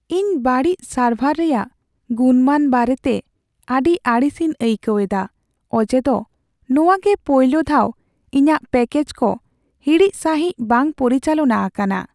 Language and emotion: Santali, sad